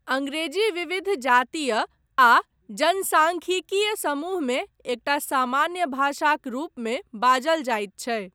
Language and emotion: Maithili, neutral